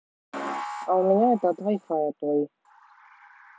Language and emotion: Russian, neutral